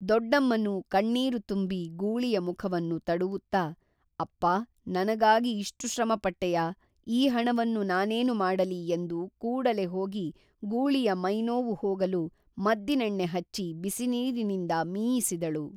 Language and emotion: Kannada, neutral